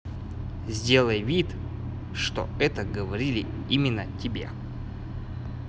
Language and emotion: Russian, neutral